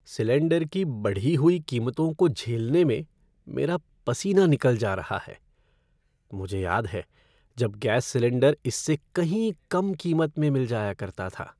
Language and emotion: Hindi, sad